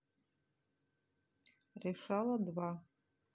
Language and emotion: Russian, neutral